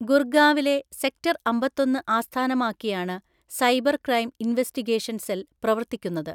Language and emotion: Malayalam, neutral